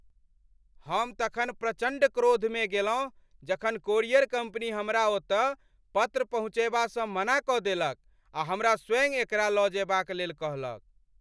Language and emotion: Maithili, angry